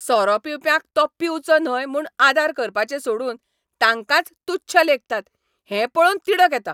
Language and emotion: Goan Konkani, angry